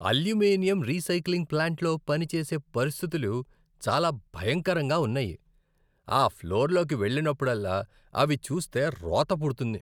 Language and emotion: Telugu, disgusted